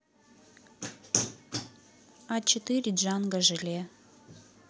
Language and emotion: Russian, neutral